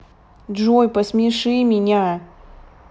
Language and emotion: Russian, angry